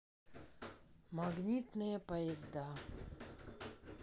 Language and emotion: Russian, sad